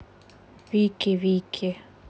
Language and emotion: Russian, neutral